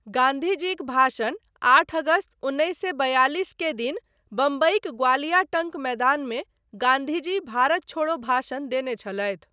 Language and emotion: Maithili, neutral